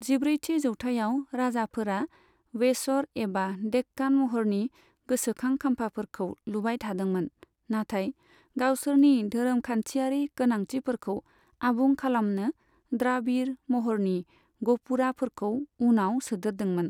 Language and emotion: Bodo, neutral